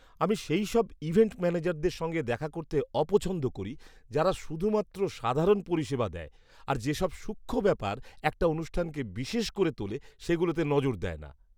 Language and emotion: Bengali, disgusted